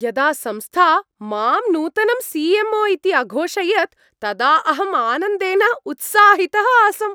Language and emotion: Sanskrit, happy